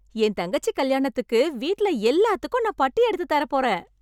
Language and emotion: Tamil, happy